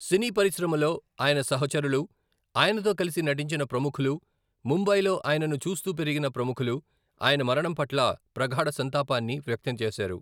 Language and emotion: Telugu, neutral